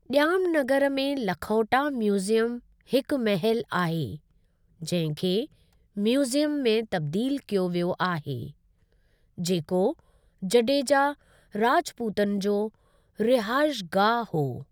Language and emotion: Sindhi, neutral